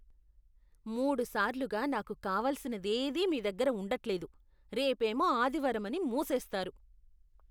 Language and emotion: Telugu, disgusted